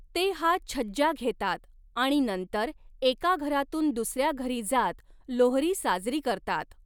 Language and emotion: Marathi, neutral